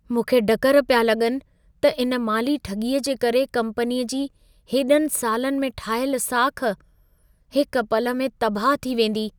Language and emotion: Sindhi, fearful